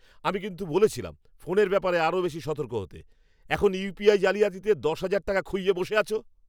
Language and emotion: Bengali, angry